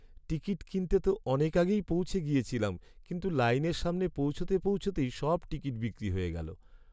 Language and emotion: Bengali, sad